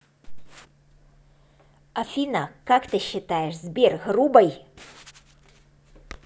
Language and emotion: Russian, neutral